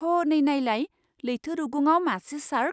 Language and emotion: Bodo, surprised